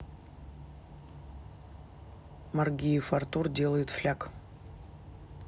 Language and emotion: Russian, neutral